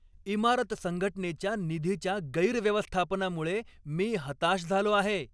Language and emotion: Marathi, angry